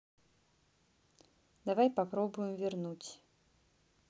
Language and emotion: Russian, neutral